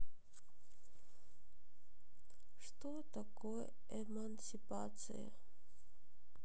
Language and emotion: Russian, sad